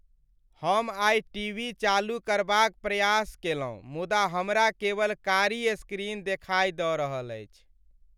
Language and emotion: Maithili, sad